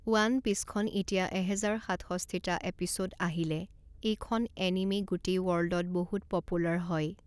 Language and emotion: Assamese, neutral